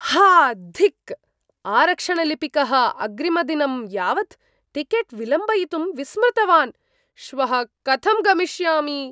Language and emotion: Sanskrit, surprised